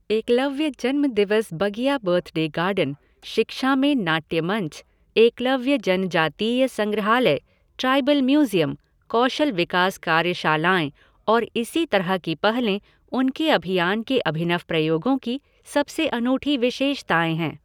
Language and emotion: Hindi, neutral